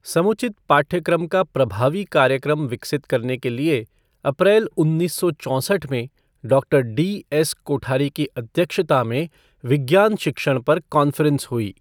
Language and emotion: Hindi, neutral